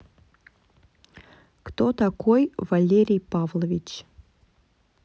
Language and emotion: Russian, neutral